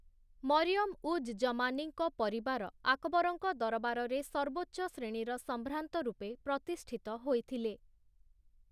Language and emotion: Odia, neutral